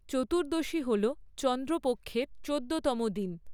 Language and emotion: Bengali, neutral